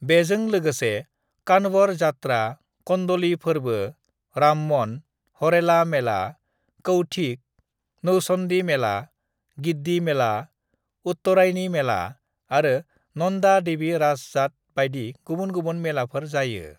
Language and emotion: Bodo, neutral